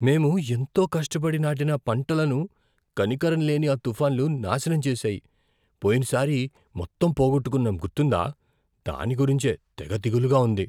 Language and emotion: Telugu, fearful